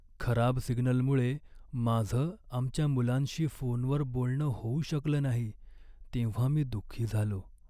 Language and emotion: Marathi, sad